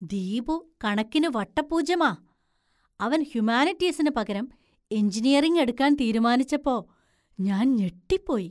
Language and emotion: Malayalam, surprised